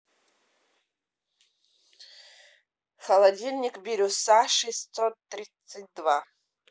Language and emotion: Russian, neutral